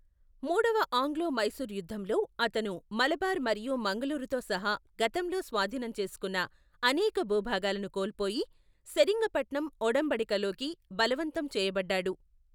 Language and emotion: Telugu, neutral